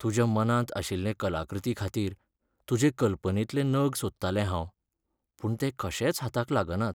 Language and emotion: Goan Konkani, sad